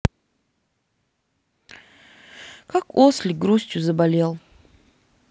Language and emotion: Russian, sad